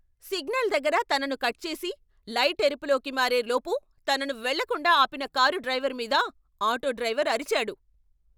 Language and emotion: Telugu, angry